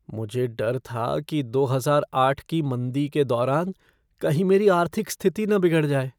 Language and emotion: Hindi, fearful